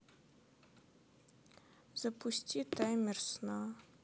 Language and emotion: Russian, sad